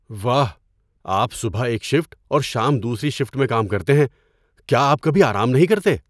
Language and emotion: Urdu, surprised